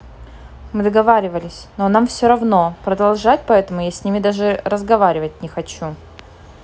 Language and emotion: Russian, neutral